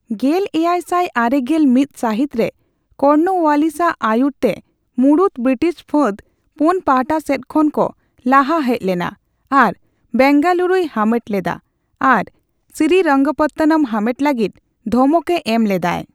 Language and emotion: Santali, neutral